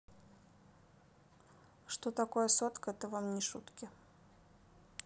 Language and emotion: Russian, neutral